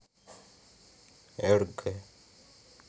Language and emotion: Russian, neutral